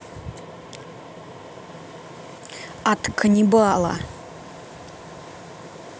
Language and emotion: Russian, angry